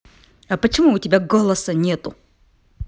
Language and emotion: Russian, angry